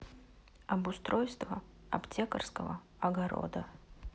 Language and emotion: Russian, neutral